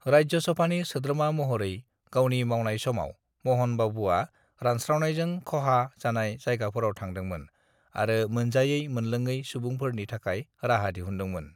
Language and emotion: Bodo, neutral